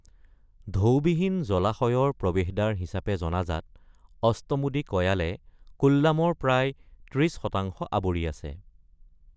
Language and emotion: Assamese, neutral